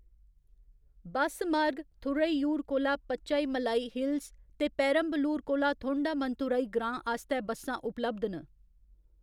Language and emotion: Dogri, neutral